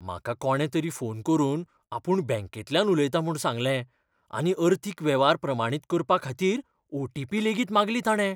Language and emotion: Goan Konkani, fearful